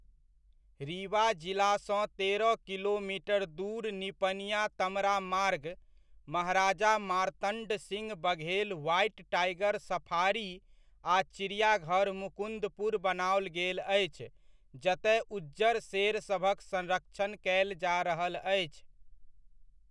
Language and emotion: Maithili, neutral